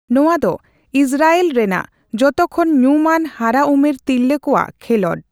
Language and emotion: Santali, neutral